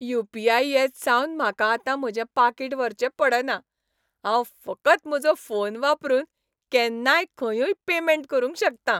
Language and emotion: Goan Konkani, happy